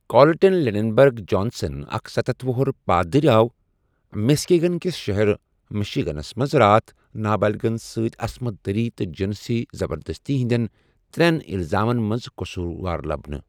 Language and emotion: Kashmiri, neutral